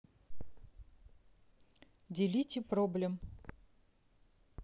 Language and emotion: Russian, neutral